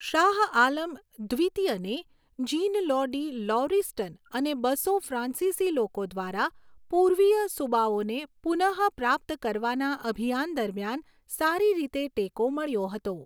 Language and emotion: Gujarati, neutral